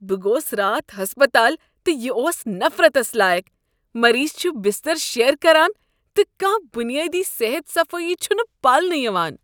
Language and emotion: Kashmiri, disgusted